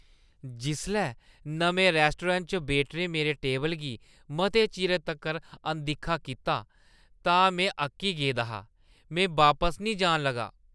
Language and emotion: Dogri, disgusted